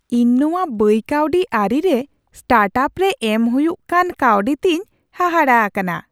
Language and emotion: Santali, surprised